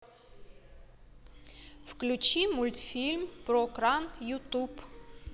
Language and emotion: Russian, neutral